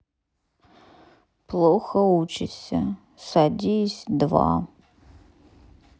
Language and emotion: Russian, sad